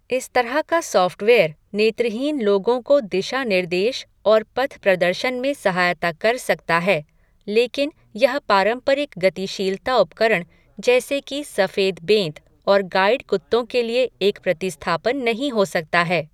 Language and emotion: Hindi, neutral